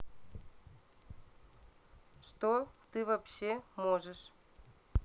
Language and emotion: Russian, neutral